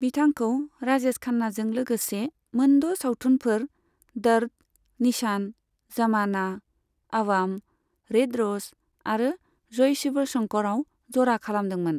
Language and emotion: Bodo, neutral